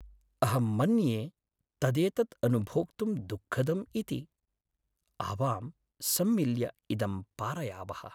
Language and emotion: Sanskrit, sad